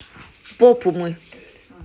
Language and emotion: Russian, neutral